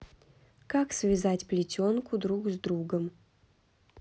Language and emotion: Russian, neutral